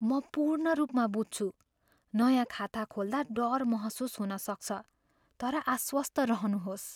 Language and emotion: Nepali, fearful